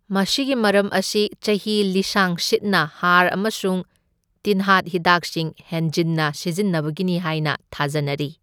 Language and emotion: Manipuri, neutral